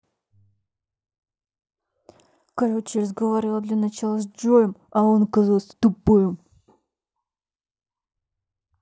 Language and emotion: Russian, angry